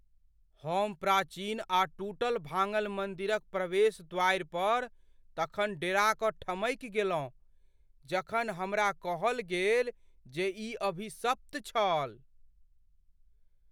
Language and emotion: Maithili, fearful